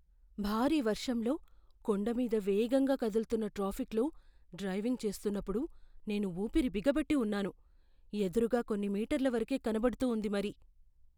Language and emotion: Telugu, fearful